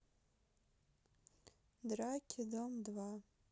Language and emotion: Russian, neutral